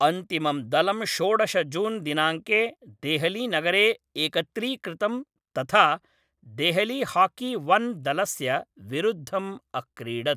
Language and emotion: Sanskrit, neutral